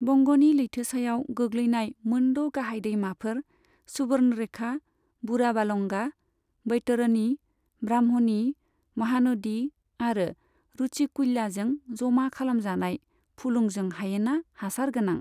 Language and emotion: Bodo, neutral